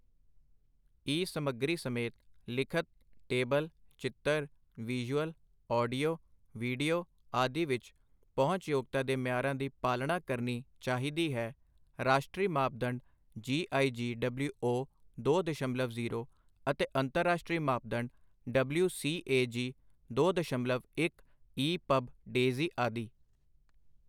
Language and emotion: Punjabi, neutral